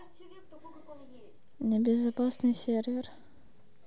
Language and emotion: Russian, neutral